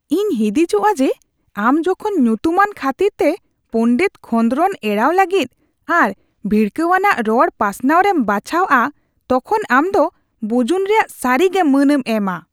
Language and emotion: Santali, disgusted